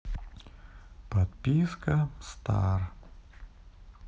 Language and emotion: Russian, sad